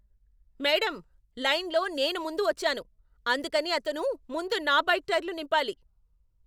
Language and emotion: Telugu, angry